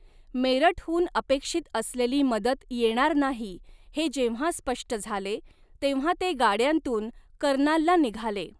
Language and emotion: Marathi, neutral